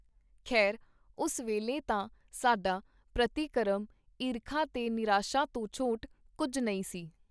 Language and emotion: Punjabi, neutral